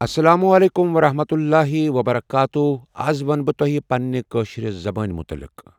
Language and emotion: Kashmiri, neutral